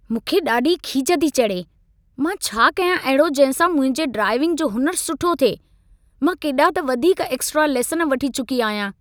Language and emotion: Sindhi, angry